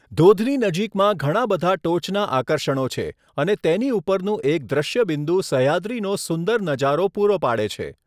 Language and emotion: Gujarati, neutral